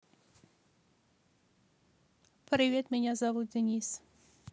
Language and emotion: Russian, neutral